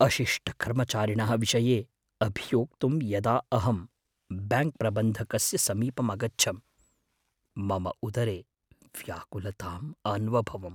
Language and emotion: Sanskrit, fearful